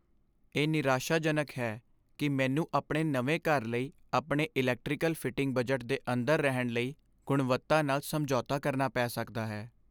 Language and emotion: Punjabi, sad